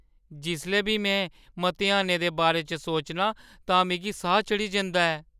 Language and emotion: Dogri, fearful